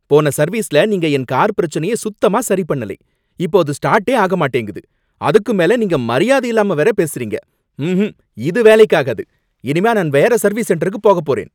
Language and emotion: Tamil, angry